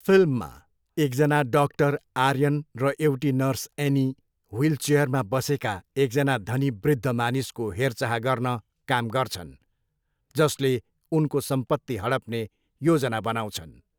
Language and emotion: Nepali, neutral